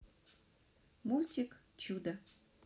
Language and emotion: Russian, neutral